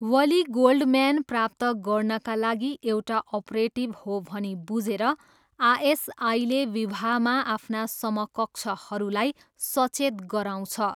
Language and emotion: Nepali, neutral